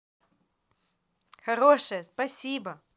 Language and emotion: Russian, positive